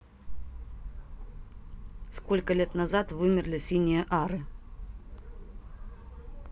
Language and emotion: Russian, neutral